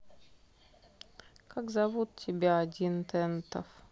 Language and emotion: Russian, sad